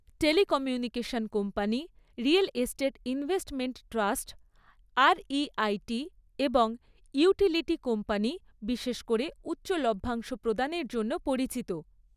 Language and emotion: Bengali, neutral